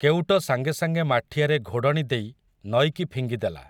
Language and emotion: Odia, neutral